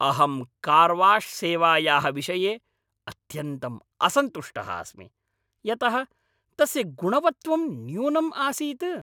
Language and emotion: Sanskrit, angry